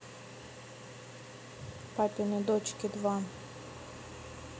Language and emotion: Russian, neutral